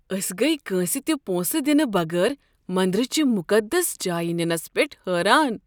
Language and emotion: Kashmiri, surprised